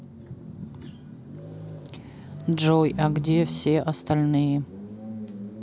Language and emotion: Russian, neutral